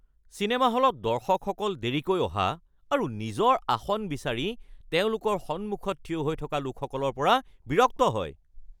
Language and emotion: Assamese, angry